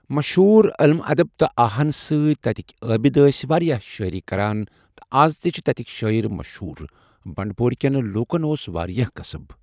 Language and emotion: Kashmiri, neutral